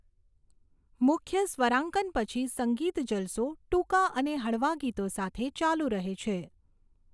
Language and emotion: Gujarati, neutral